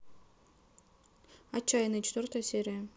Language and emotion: Russian, neutral